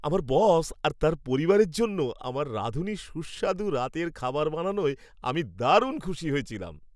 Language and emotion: Bengali, happy